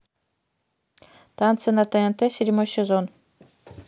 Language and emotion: Russian, neutral